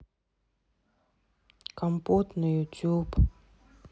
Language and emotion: Russian, sad